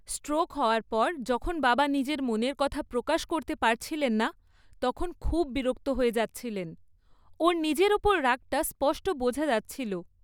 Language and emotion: Bengali, angry